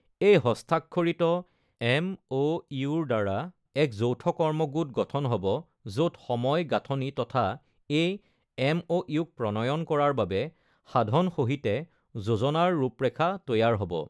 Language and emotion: Assamese, neutral